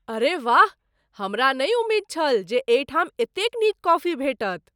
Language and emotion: Maithili, surprised